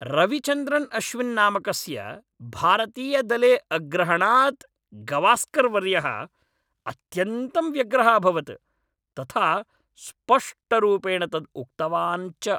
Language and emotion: Sanskrit, angry